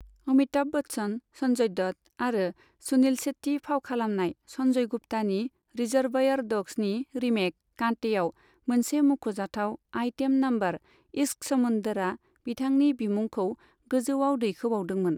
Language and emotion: Bodo, neutral